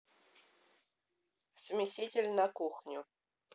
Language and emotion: Russian, neutral